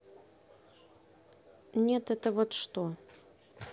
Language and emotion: Russian, neutral